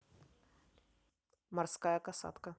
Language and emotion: Russian, neutral